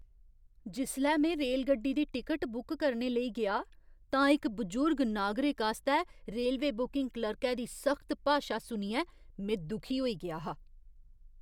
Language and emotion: Dogri, disgusted